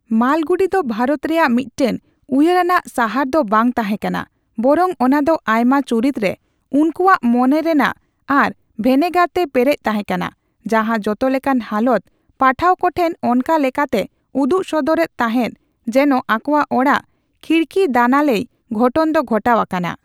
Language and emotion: Santali, neutral